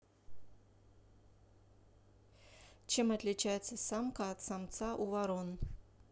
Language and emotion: Russian, neutral